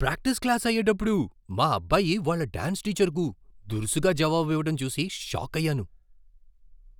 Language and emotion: Telugu, surprised